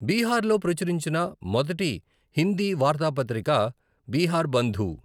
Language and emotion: Telugu, neutral